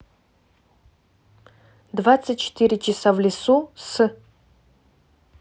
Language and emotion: Russian, neutral